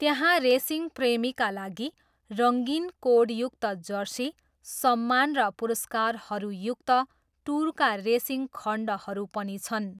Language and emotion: Nepali, neutral